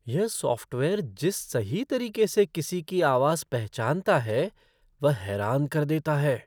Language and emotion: Hindi, surprised